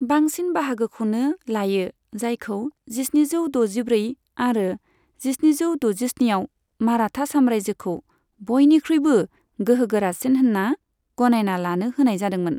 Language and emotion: Bodo, neutral